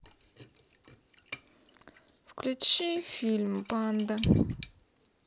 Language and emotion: Russian, neutral